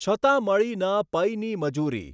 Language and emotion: Gujarati, neutral